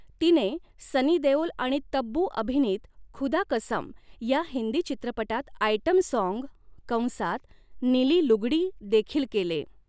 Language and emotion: Marathi, neutral